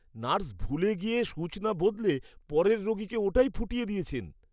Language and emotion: Bengali, disgusted